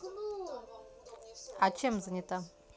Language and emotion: Russian, neutral